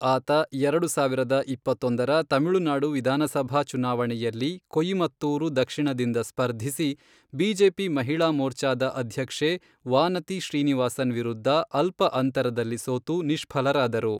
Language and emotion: Kannada, neutral